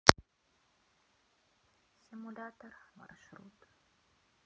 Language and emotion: Russian, sad